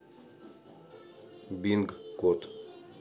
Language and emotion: Russian, neutral